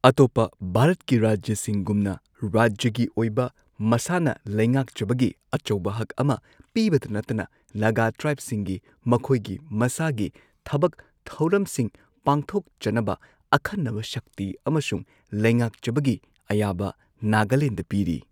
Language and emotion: Manipuri, neutral